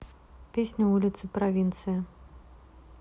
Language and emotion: Russian, neutral